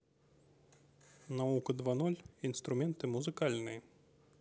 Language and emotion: Russian, neutral